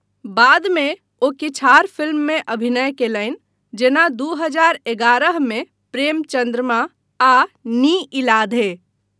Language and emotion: Maithili, neutral